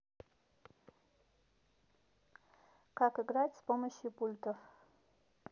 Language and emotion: Russian, neutral